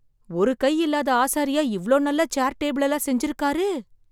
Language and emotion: Tamil, surprised